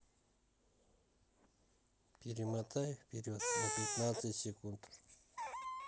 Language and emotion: Russian, neutral